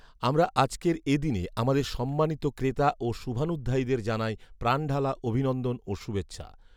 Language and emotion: Bengali, neutral